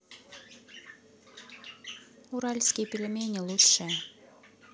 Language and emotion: Russian, neutral